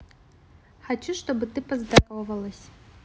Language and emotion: Russian, neutral